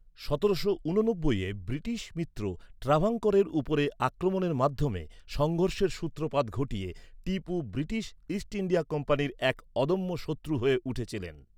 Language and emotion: Bengali, neutral